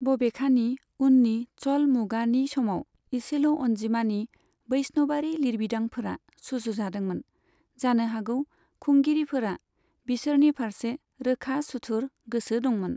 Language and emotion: Bodo, neutral